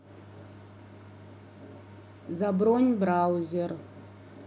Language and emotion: Russian, neutral